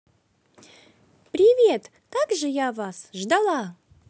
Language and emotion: Russian, positive